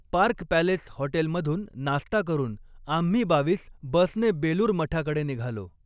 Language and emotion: Marathi, neutral